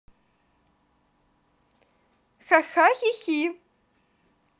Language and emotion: Russian, positive